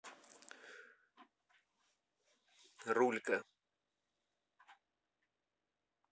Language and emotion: Russian, neutral